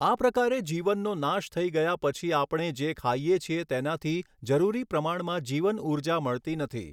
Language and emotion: Gujarati, neutral